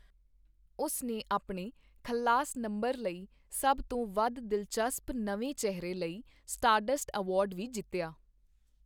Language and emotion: Punjabi, neutral